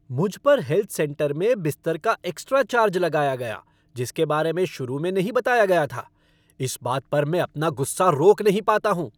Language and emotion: Hindi, angry